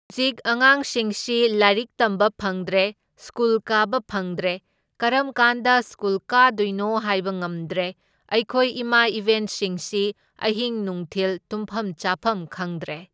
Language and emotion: Manipuri, neutral